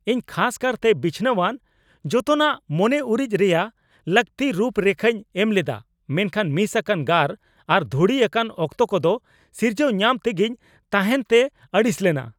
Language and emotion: Santali, angry